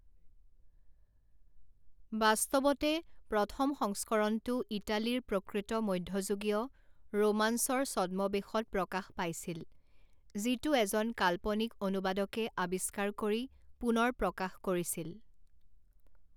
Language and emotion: Assamese, neutral